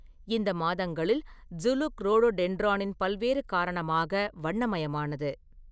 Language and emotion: Tamil, neutral